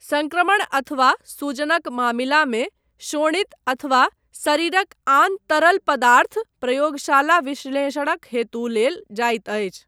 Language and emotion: Maithili, neutral